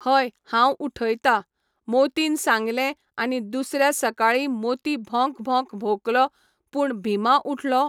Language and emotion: Goan Konkani, neutral